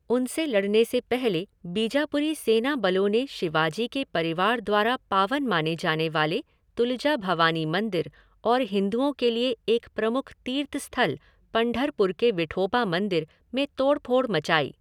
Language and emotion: Hindi, neutral